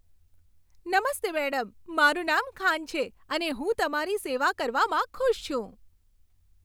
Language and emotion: Gujarati, happy